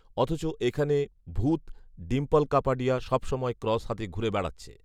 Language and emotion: Bengali, neutral